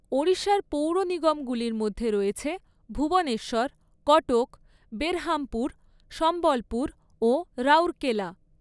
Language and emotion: Bengali, neutral